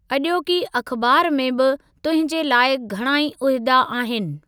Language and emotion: Sindhi, neutral